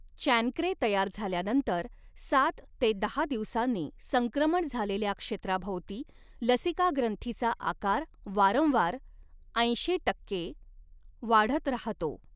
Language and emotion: Marathi, neutral